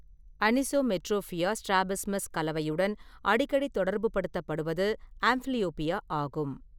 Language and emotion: Tamil, neutral